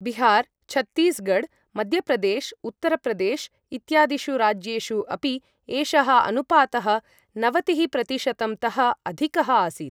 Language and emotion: Sanskrit, neutral